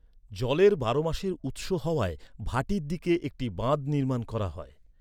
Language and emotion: Bengali, neutral